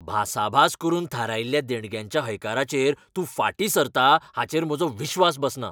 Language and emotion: Goan Konkani, angry